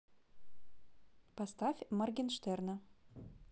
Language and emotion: Russian, neutral